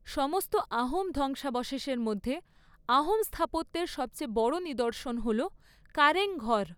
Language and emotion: Bengali, neutral